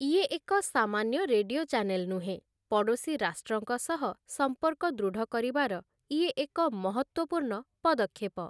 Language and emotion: Odia, neutral